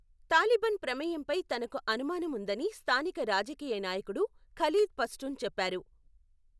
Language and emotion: Telugu, neutral